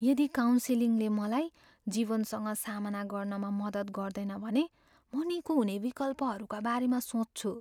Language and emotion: Nepali, fearful